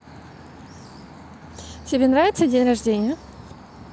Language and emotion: Russian, positive